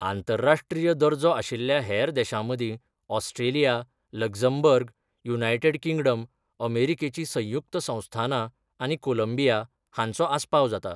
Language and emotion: Goan Konkani, neutral